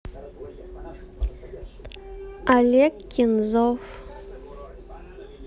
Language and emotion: Russian, neutral